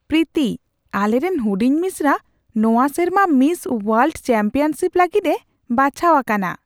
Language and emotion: Santali, surprised